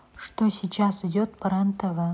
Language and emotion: Russian, neutral